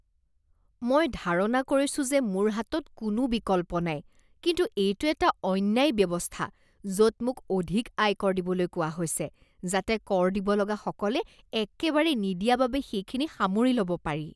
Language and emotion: Assamese, disgusted